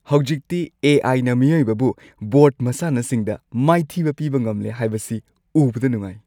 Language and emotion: Manipuri, happy